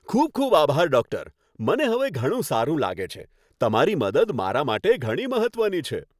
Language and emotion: Gujarati, happy